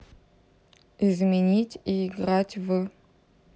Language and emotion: Russian, neutral